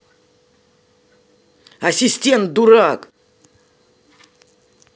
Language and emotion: Russian, angry